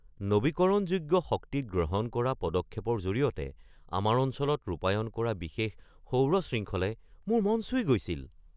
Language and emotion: Assamese, surprised